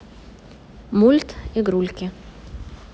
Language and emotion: Russian, neutral